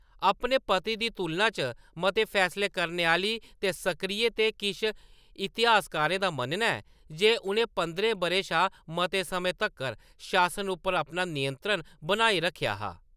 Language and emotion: Dogri, neutral